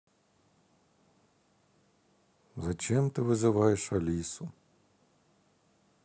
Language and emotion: Russian, sad